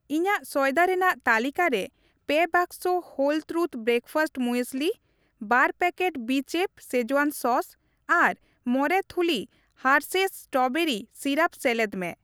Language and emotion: Santali, neutral